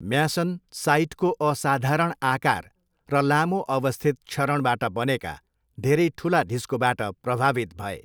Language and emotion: Nepali, neutral